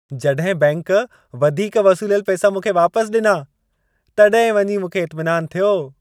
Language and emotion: Sindhi, happy